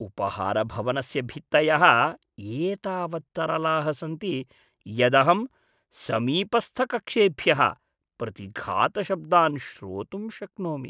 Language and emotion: Sanskrit, disgusted